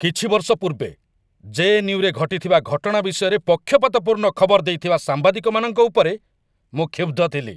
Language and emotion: Odia, angry